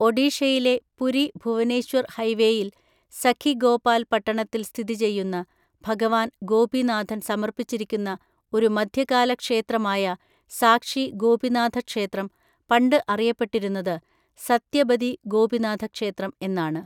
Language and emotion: Malayalam, neutral